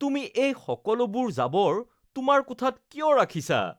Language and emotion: Assamese, disgusted